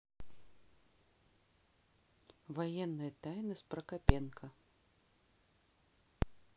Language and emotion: Russian, neutral